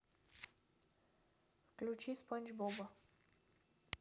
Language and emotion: Russian, neutral